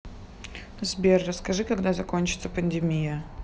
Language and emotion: Russian, neutral